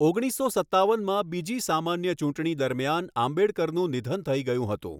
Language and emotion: Gujarati, neutral